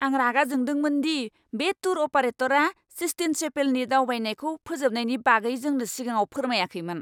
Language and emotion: Bodo, angry